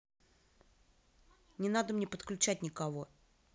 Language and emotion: Russian, angry